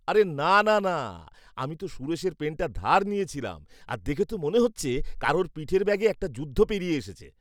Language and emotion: Bengali, disgusted